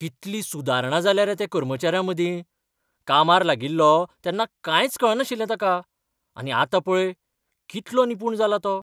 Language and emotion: Goan Konkani, surprised